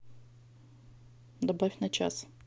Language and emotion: Russian, neutral